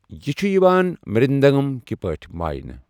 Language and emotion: Kashmiri, neutral